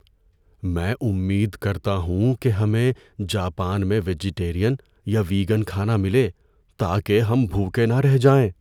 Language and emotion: Urdu, fearful